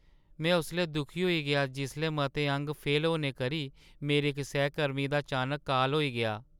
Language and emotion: Dogri, sad